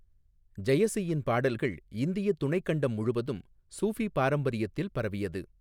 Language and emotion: Tamil, neutral